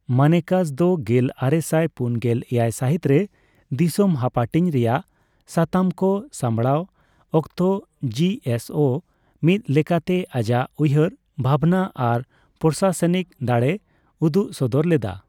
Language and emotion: Santali, neutral